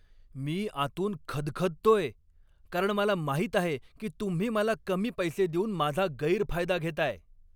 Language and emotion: Marathi, angry